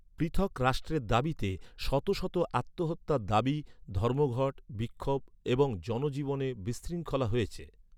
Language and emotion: Bengali, neutral